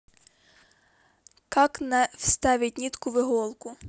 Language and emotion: Russian, neutral